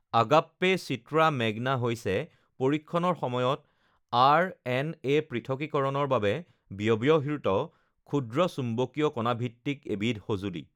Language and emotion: Assamese, neutral